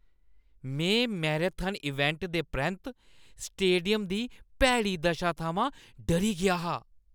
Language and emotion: Dogri, disgusted